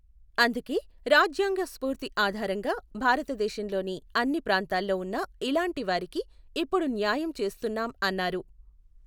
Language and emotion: Telugu, neutral